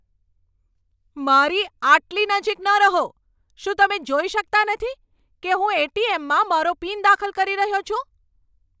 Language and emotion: Gujarati, angry